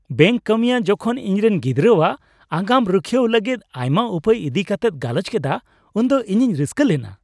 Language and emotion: Santali, happy